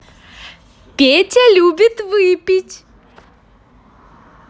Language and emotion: Russian, positive